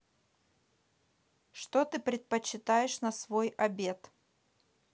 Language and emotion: Russian, neutral